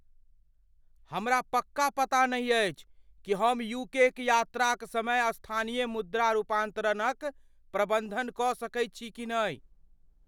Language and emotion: Maithili, fearful